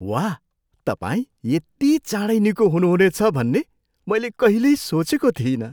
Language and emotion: Nepali, surprised